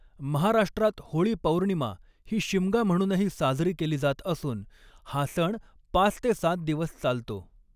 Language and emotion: Marathi, neutral